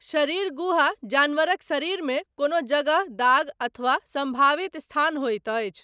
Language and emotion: Maithili, neutral